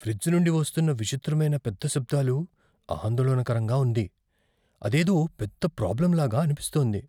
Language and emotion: Telugu, fearful